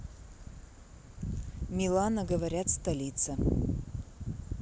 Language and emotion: Russian, neutral